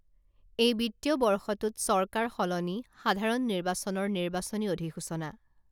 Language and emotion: Assamese, neutral